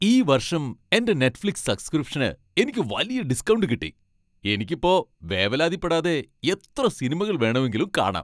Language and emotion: Malayalam, happy